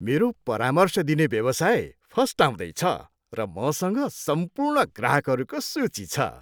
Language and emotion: Nepali, happy